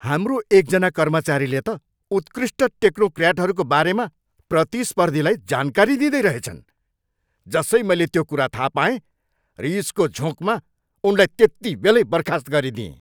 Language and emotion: Nepali, angry